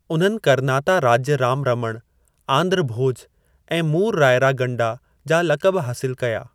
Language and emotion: Sindhi, neutral